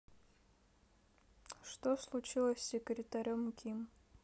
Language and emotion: Russian, neutral